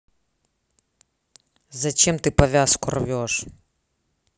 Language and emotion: Russian, angry